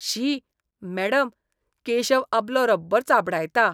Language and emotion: Goan Konkani, disgusted